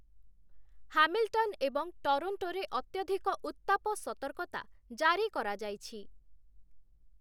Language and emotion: Odia, neutral